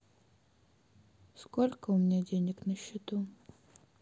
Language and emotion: Russian, sad